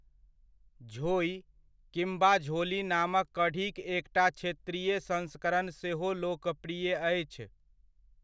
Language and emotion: Maithili, neutral